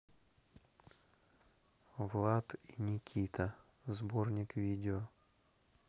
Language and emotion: Russian, neutral